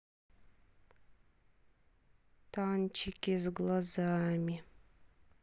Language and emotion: Russian, sad